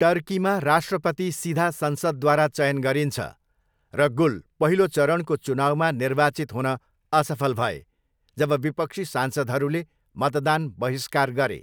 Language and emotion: Nepali, neutral